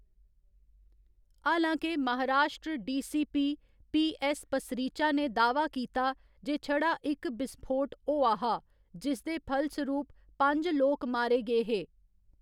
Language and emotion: Dogri, neutral